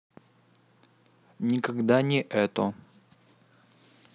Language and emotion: Russian, neutral